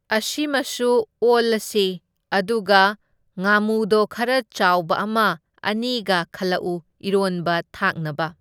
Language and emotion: Manipuri, neutral